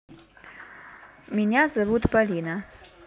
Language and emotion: Russian, neutral